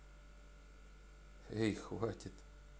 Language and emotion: Russian, neutral